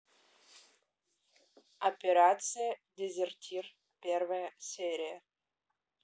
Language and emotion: Russian, neutral